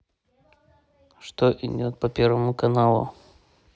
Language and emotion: Russian, neutral